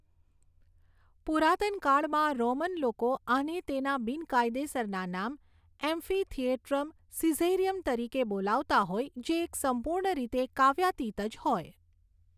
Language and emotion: Gujarati, neutral